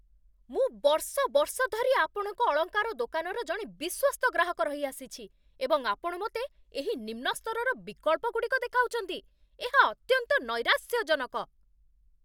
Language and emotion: Odia, angry